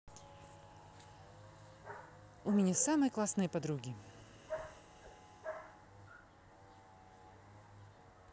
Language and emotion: Russian, positive